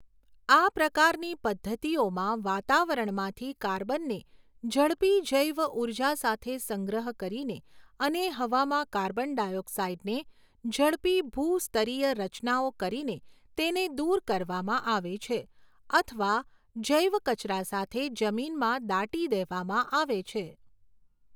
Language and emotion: Gujarati, neutral